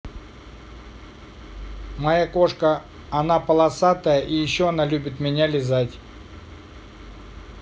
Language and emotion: Russian, neutral